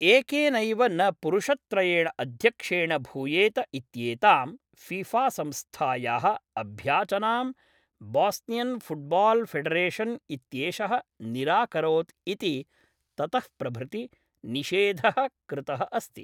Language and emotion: Sanskrit, neutral